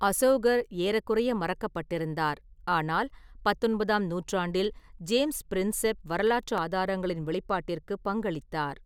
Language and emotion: Tamil, neutral